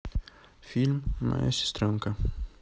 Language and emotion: Russian, neutral